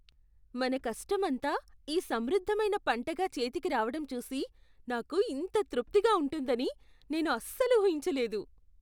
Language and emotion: Telugu, surprised